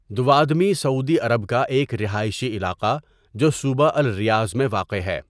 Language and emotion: Urdu, neutral